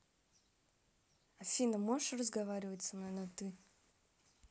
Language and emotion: Russian, neutral